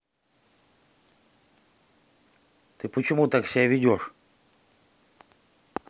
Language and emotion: Russian, angry